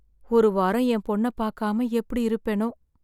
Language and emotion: Tamil, sad